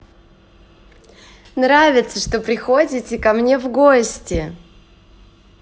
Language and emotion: Russian, positive